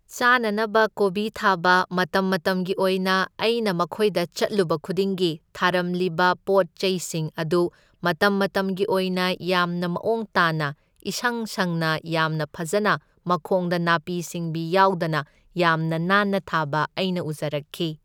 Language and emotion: Manipuri, neutral